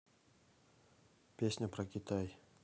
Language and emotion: Russian, neutral